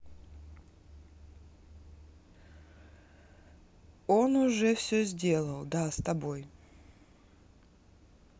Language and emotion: Russian, neutral